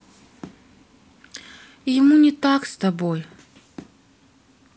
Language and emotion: Russian, sad